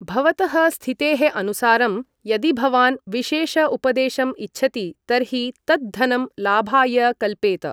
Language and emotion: Sanskrit, neutral